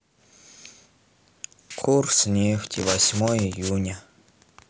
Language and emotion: Russian, sad